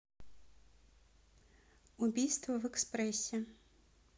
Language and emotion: Russian, neutral